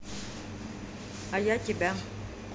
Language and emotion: Russian, neutral